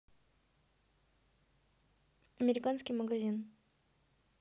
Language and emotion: Russian, neutral